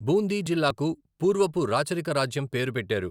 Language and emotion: Telugu, neutral